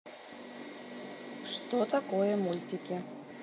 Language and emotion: Russian, neutral